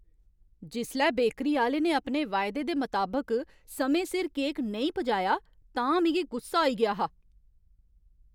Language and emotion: Dogri, angry